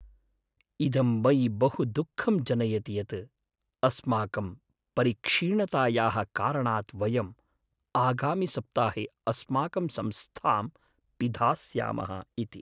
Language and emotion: Sanskrit, sad